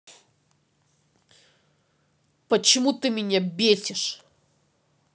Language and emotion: Russian, angry